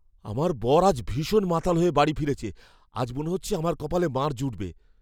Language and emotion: Bengali, fearful